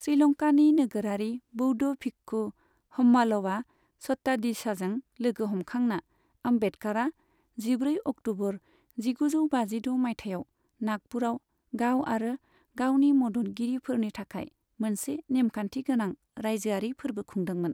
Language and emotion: Bodo, neutral